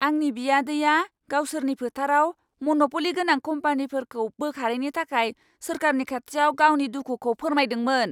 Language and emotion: Bodo, angry